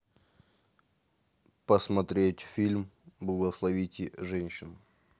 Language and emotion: Russian, neutral